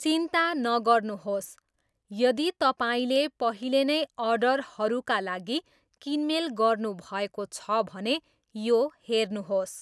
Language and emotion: Nepali, neutral